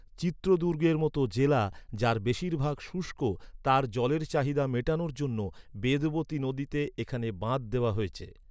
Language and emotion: Bengali, neutral